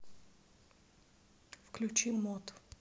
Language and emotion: Russian, neutral